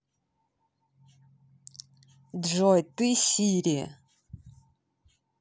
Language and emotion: Russian, neutral